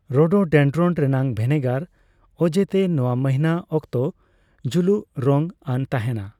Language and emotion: Santali, neutral